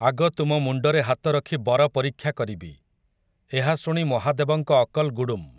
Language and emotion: Odia, neutral